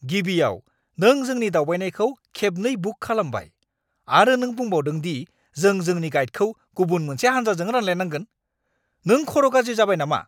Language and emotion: Bodo, angry